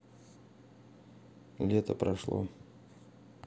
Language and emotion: Russian, neutral